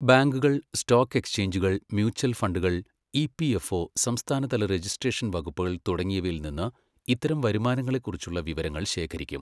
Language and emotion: Malayalam, neutral